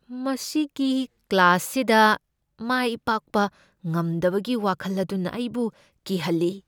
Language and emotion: Manipuri, fearful